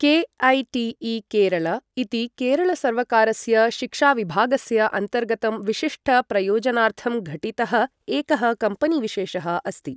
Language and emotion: Sanskrit, neutral